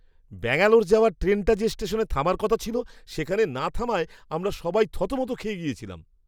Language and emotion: Bengali, surprised